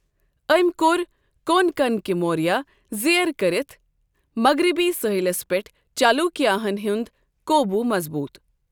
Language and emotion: Kashmiri, neutral